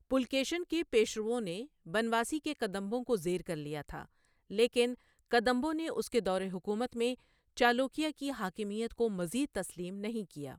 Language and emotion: Urdu, neutral